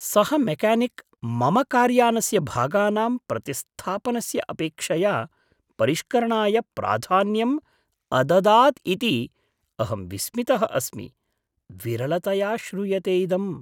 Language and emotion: Sanskrit, surprised